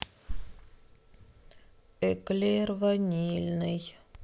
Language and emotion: Russian, sad